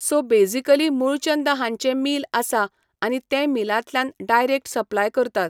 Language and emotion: Goan Konkani, neutral